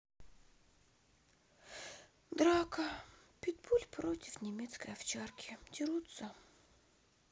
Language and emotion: Russian, sad